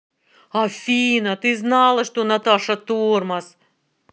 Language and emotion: Russian, angry